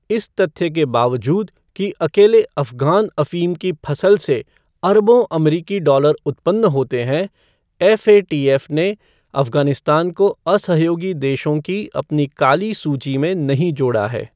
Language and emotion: Hindi, neutral